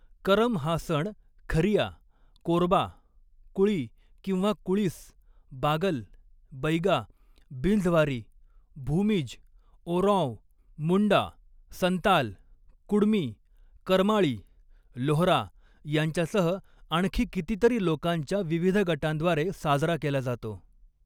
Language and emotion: Marathi, neutral